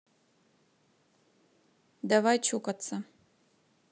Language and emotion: Russian, neutral